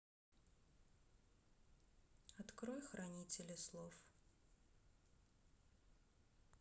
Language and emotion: Russian, sad